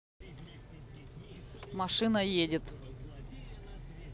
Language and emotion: Russian, neutral